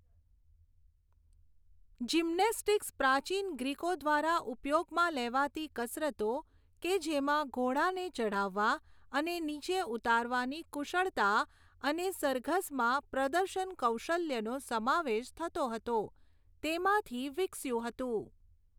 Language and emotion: Gujarati, neutral